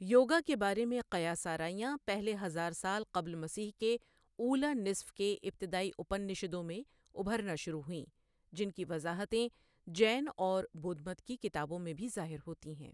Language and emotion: Urdu, neutral